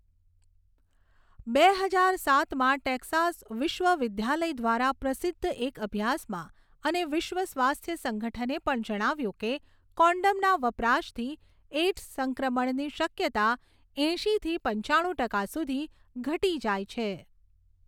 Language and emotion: Gujarati, neutral